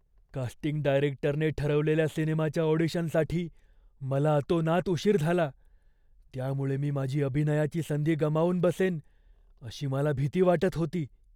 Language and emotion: Marathi, fearful